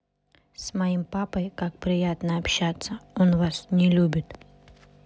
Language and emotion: Russian, neutral